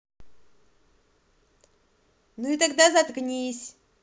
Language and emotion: Russian, neutral